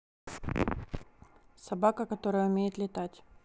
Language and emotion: Russian, neutral